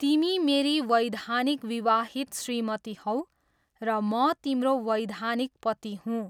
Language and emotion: Nepali, neutral